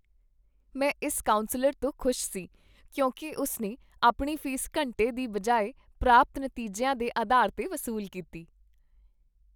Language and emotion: Punjabi, happy